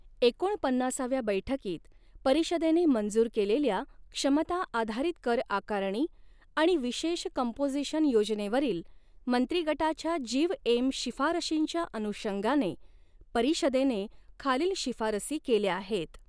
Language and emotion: Marathi, neutral